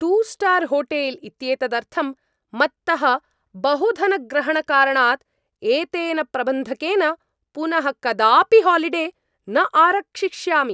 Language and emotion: Sanskrit, angry